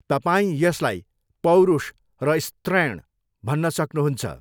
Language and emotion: Nepali, neutral